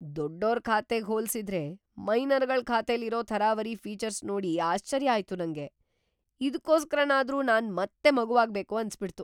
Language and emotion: Kannada, surprised